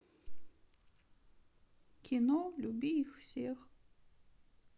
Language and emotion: Russian, sad